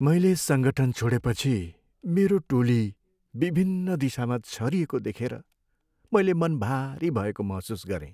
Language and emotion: Nepali, sad